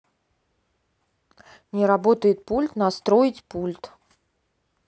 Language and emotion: Russian, neutral